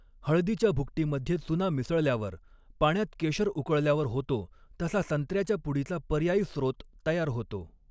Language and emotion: Marathi, neutral